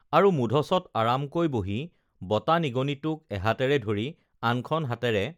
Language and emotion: Assamese, neutral